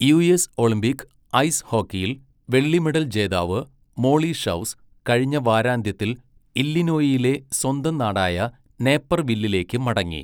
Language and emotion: Malayalam, neutral